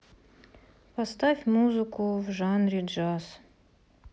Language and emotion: Russian, neutral